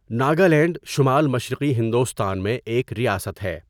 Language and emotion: Urdu, neutral